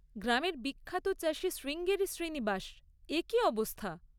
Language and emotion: Bengali, neutral